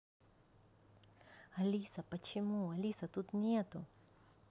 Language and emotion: Russian, neutral